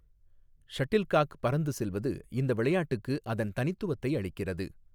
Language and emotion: Tamil, neutral